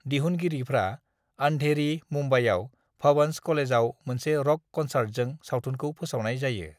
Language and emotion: Bodo, neutral